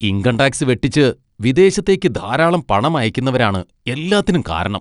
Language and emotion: Malayalam, disgusted